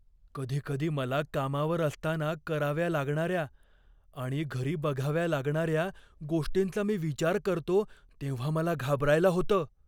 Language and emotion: Marathi, fearful